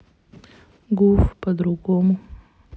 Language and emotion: Russian, neutral